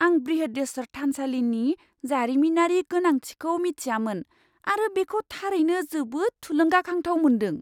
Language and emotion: Bodo, surprised